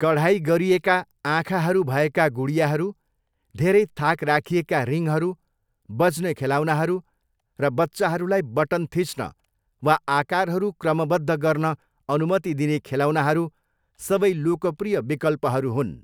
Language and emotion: Nepali, neutral